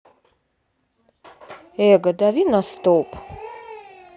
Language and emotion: Russian, neutral